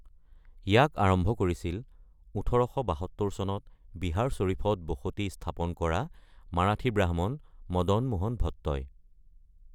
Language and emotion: Assamese, neutral